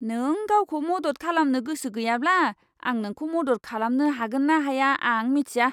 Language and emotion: Bodo, disgusted